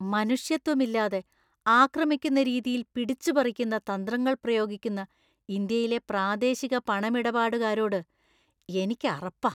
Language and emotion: Malayalam, disgusted